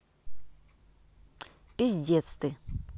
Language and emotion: Russian, neutral